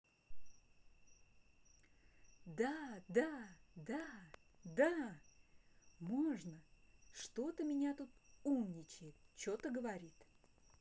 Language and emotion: Russian, positive